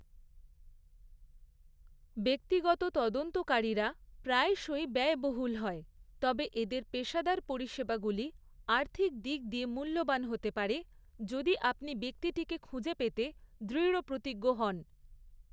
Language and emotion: Bengali, neutral